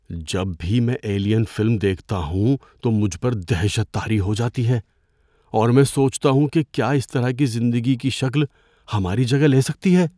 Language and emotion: Urdu, fearful